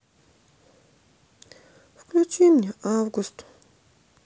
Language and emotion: Russian, sad